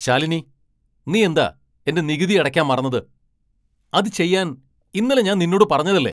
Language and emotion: Malayalam, angry